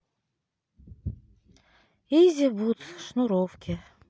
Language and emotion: Russian, sad